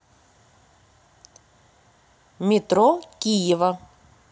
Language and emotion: Russian, neutral